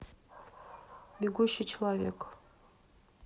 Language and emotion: Russian, neutral